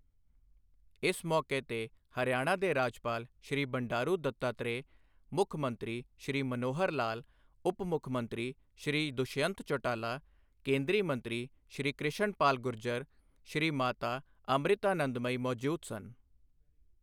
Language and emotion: Punjabi, neutral